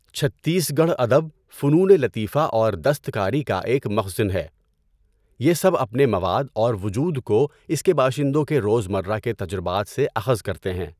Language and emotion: Urdu, neutral